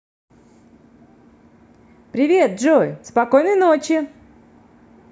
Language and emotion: Russian, positive